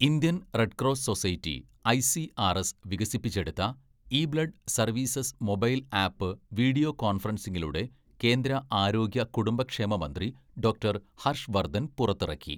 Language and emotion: Malayalam, neutral